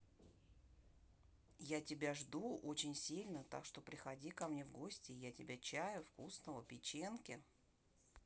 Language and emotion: Russian, neutral